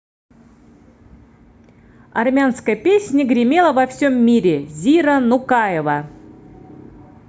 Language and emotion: Russian, positive